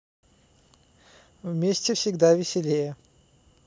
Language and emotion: Russian, neutral